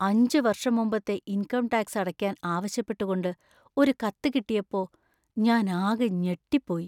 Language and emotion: Malayalam, fearful